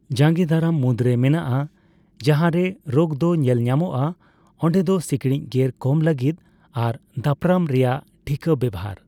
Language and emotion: Santali, neutral